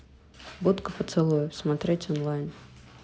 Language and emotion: Russian, neutral